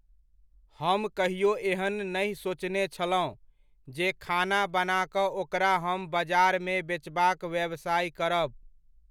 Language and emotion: Maithili, neutral